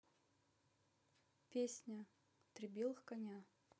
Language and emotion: Russian, neutral